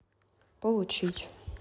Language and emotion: Russian, neutral